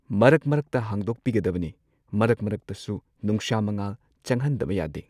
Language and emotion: Manipuri, neutral